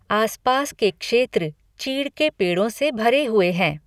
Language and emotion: Hindi, neutral